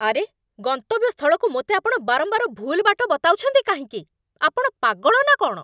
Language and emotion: Odia, angry